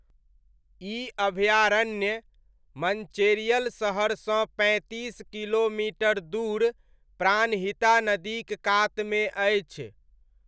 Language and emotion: Maithili, neutral